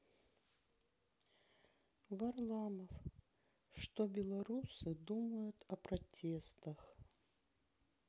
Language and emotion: Russian, sad